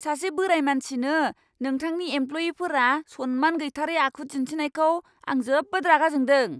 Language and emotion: Bodo, angry